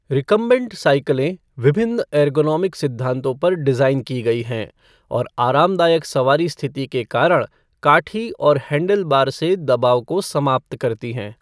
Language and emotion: Hindi, neutral